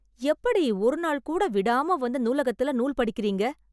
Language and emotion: Tamil, surprised